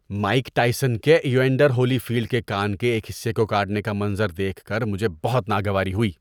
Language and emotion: Urdu, disgusted